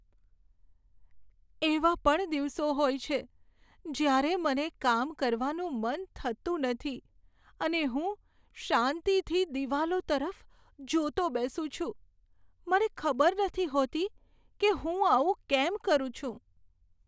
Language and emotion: Gujarati, sad